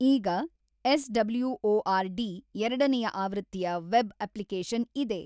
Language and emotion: Kannada, neutral